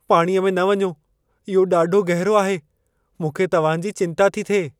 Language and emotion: Sindhi, fearful